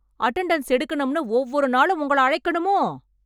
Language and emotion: Tamil, angry